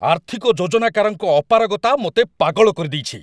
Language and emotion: Odia, angry